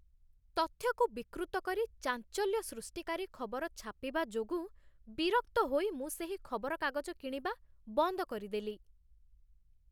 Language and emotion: Odia, disgusted